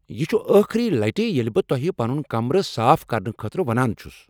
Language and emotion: Kashmiri, angry